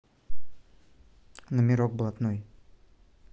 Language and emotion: Russian, neutral